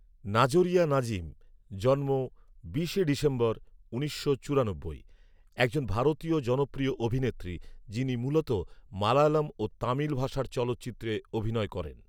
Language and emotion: Bengali, neutral